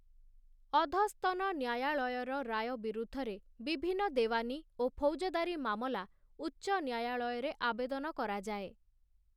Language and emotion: Odia, neutral